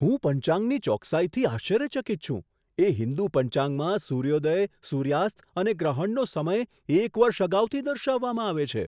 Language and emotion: Gujarati, surprised